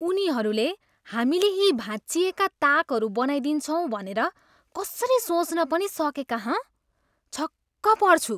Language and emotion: Nepali, disgusted